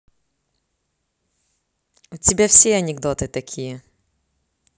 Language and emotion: Russian, neutral